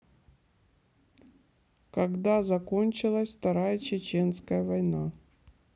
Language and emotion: Russian, neutral